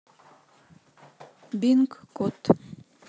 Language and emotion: Russian, neutral